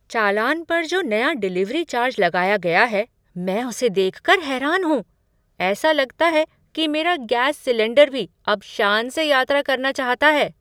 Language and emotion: Hindi, surprised